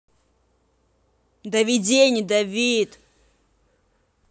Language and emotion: Russian, angry